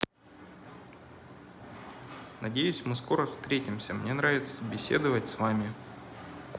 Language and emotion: Russian, positive